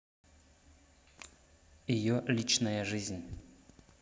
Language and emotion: Russian, neutral